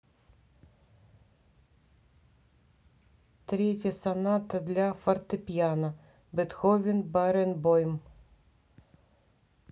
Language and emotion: Russian, neutral